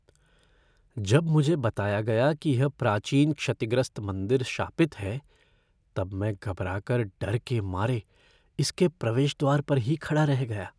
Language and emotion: Hindi, fearful